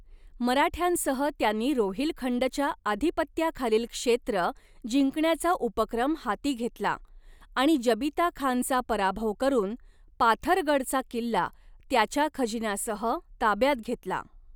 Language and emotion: Marathi, neutral